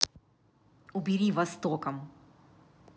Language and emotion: Russian, angry